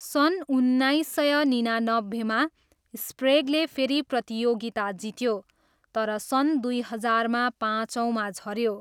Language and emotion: Nepali, neutral